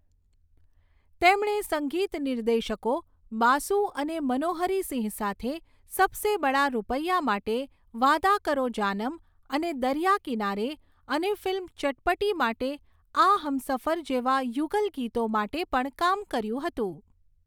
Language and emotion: Gujarati, neutral